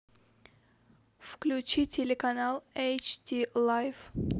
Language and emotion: Russian, neutral